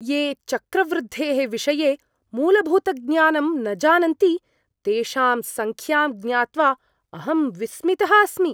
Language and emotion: Sanskrit, surprised